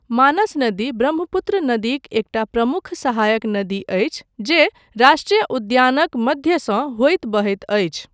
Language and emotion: Maithili, neutral